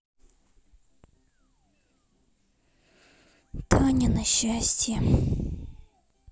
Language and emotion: Russian, sad